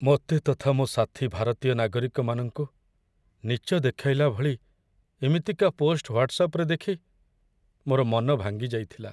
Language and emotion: Odia, sad